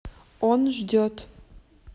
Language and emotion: Russian, neutral